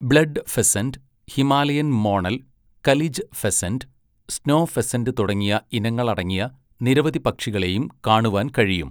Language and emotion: Malayalam, neutral